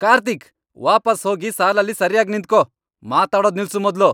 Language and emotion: Kannada, angry